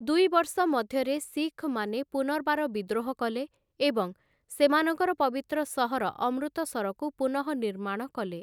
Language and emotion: Odia, neutral